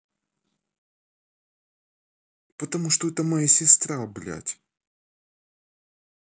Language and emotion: Russian, angry